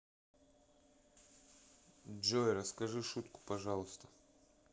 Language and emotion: Russian, neutral